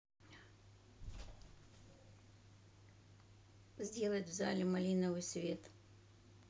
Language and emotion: Russian, neutral